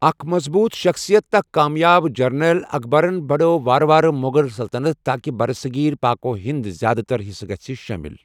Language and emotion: Kashmiri, neutral